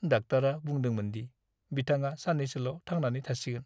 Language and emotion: Bodo, sad